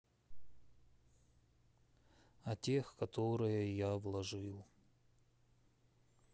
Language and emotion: Russian, sad